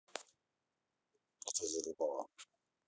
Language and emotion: Russian, angry